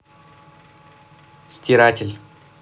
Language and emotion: Russian, neutral